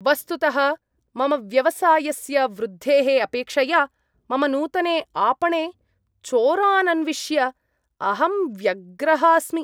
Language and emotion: Sanskrit, disgusted